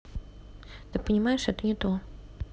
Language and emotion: Russian, neutral